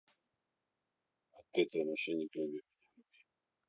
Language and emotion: Russian, neutral